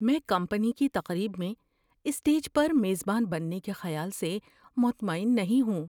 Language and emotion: Urdu, fearful